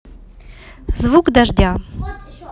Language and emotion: Russian, neutral